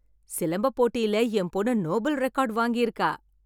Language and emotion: Tamil, happy